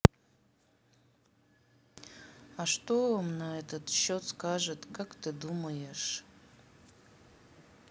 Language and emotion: Russian, neutral